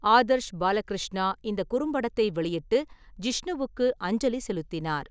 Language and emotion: Tamil, neutral